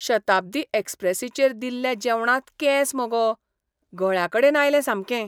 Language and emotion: Goan Konkani, disgusted